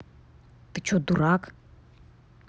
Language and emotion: Russian, angry